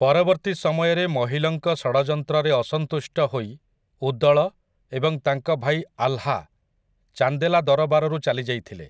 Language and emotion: Odia, neutral